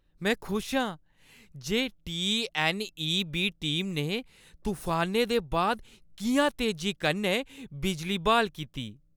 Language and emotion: Dogri, happy